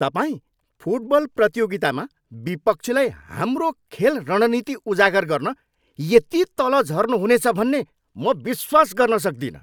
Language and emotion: Nepali, angry